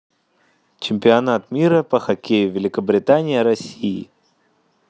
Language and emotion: Russian, neutral